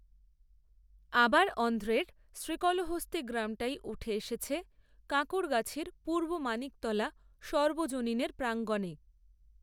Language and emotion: Bengali, neutral